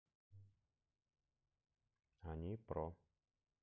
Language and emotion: Russian, neutral